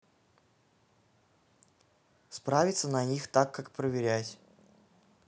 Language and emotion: Russian, neutral